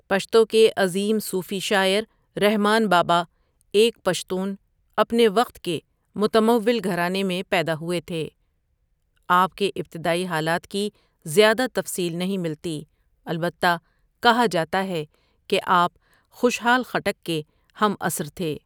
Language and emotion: Urdu, neutral